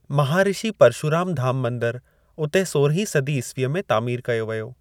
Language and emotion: Sindhi, neutral